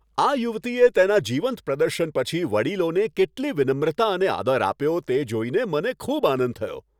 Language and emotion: Gujarati, happy